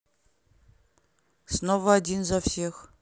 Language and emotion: Russian, neutral